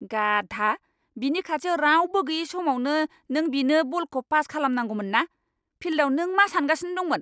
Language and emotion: Bodo, angry